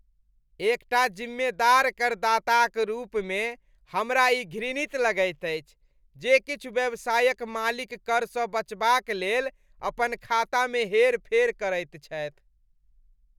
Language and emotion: Maithili, disgusted